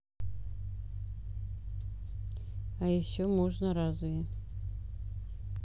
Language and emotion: Russian, neutral